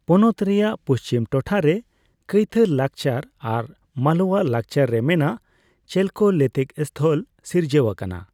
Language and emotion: Santali, neutral